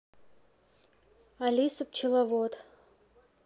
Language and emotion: Russian, neutral